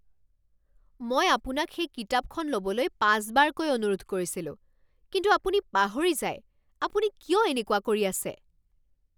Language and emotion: Assamese, angry